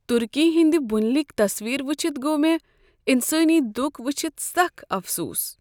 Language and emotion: Kashmiri, sad